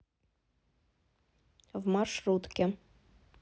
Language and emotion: Russian, neutral